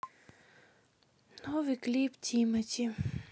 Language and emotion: Russian, sad